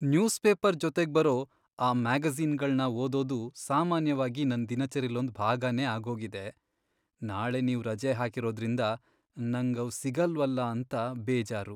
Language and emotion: Kannada, sad